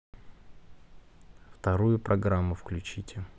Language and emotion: Russian, neutral